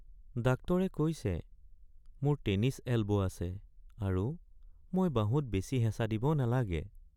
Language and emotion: Assamese, sad